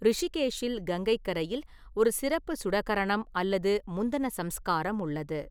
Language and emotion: Tamil, neutral